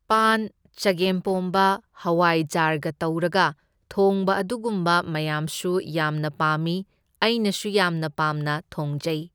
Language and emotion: Manipuri, neutral